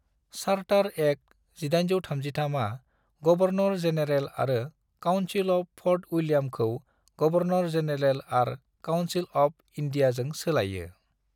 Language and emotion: Bodo, neutral